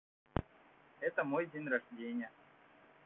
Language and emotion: Russian, neutral